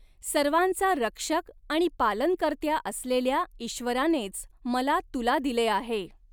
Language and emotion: Marathi, neutral